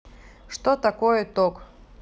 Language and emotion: Russian, neutral